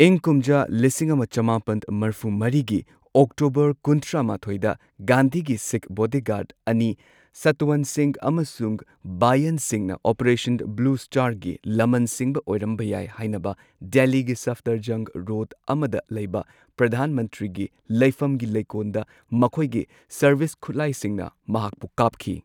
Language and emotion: Manipuri, neutral